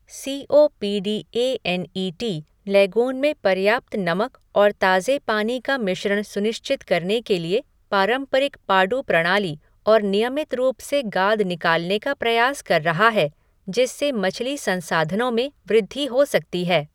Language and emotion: Hindi, neutral